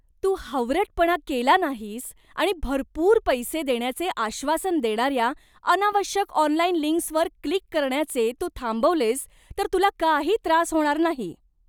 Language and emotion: Marathi, disgusted